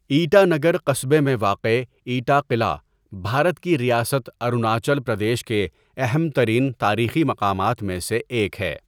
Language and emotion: Urdu, neutral